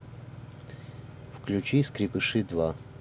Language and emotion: Russian, neutral